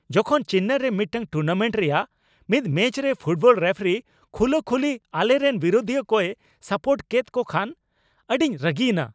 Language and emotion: Santali, angry